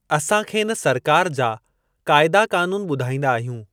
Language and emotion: Sindhi, neutral